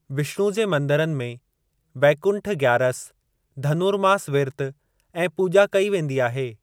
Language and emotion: Sindhi, neutral